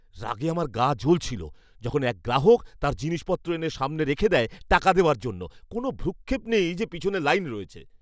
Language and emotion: Bengali, angry